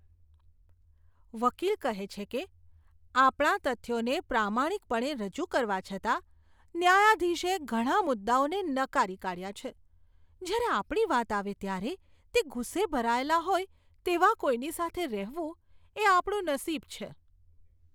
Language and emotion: Gujarati, disgusted